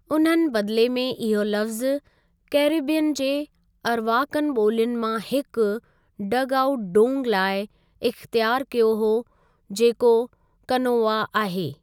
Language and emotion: Sindhi, neutral